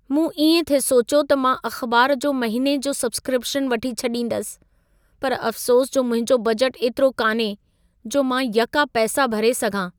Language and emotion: Sindhi, sad